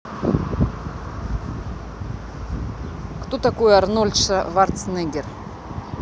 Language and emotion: Russian, neutral